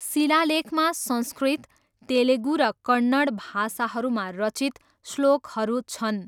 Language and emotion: Nepali, neutral